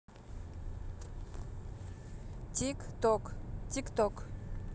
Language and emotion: Russian, neutral